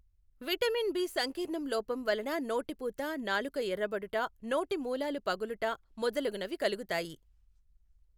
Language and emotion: Telugu, neutral